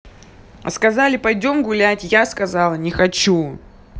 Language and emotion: Russian, angry